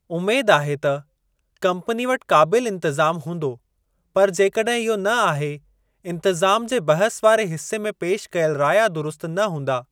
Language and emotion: Sindhi, neutral